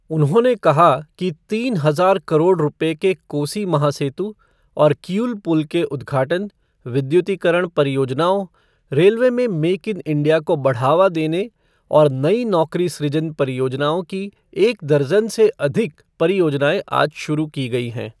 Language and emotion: Hindi, neutral